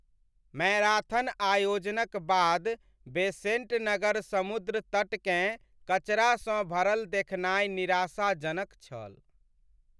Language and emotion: Maithili, sad